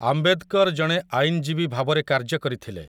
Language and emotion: Odia, neutral